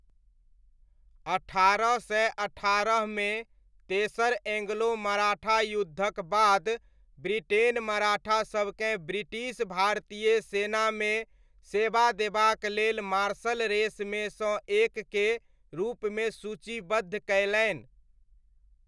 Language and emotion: Maithili, neutral